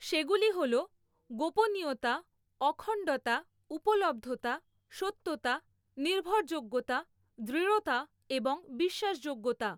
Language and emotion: Bengali, neutral